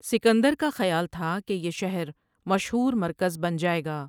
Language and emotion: Urdu, neutral